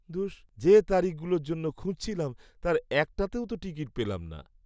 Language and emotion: Bengali, sad